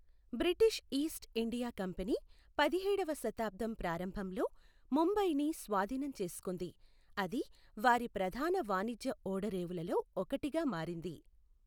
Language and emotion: Telugu, neutral